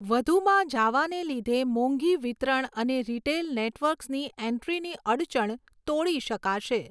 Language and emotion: Gujarati, neutral